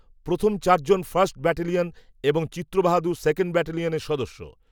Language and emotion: Bengali, neutral